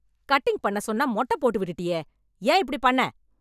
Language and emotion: Tamil, angry